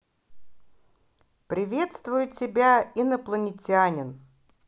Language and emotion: Russian, positive